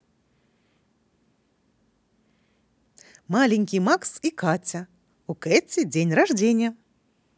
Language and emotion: Russian, positive